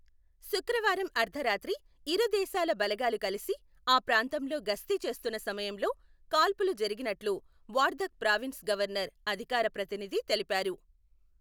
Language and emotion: Telugu, neutral